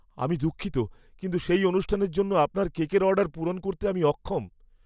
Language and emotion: Bengali, fearful